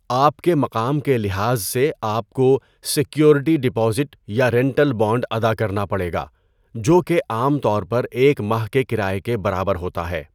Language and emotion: Urdu, neutral